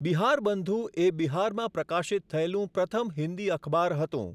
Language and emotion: Gujarati, neutral